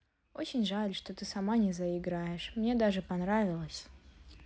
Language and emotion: Russian, sad